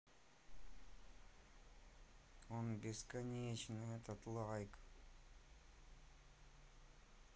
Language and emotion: Russian, sad